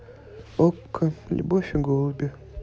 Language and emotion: Russian, neutral